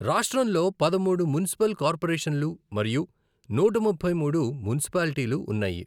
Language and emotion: Telugu, neutral